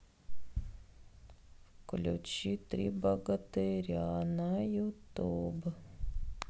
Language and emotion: Russian, sad